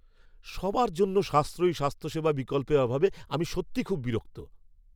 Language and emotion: Bengali, angry